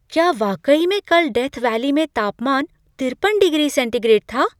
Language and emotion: Hindi, surprised